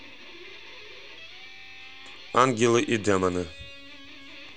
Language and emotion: Russian, neutral